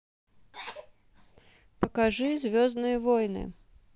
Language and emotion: Russian, neutral